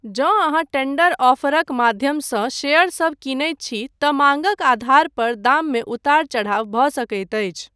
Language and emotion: Maithili, neutral